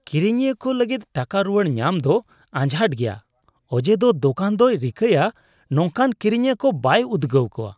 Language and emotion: Santali, disgusted